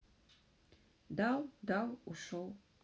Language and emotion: Russian, neutral